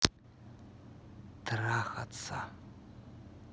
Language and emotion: Russian, neutral